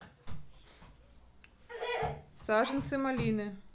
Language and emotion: Russian, neutral